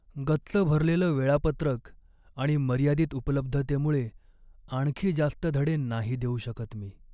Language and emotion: Marathi, sad